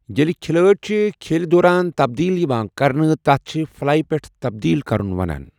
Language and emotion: Kashmiri, neutral